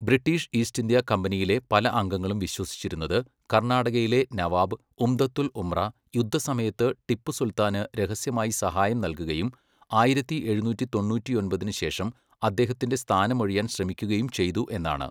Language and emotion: Malayalam, neutral